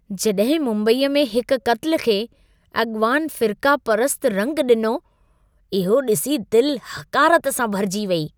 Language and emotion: Sindhi, disgusted